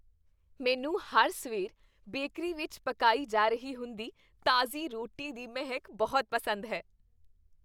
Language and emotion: Punjabi, happy